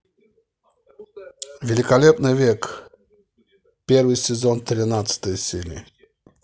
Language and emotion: Russian, neutral